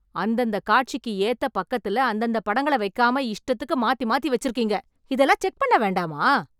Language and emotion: Tamil, angry